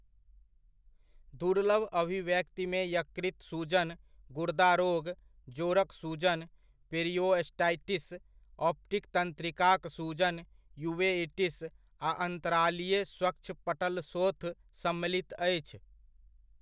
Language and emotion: Maithili, neutral